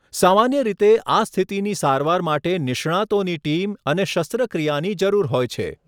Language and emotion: Gujarati, neutral